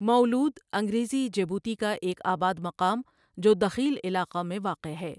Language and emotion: Urdu, neutral